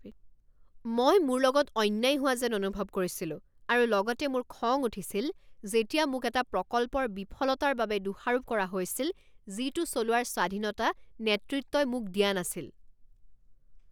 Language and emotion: Assamese, angry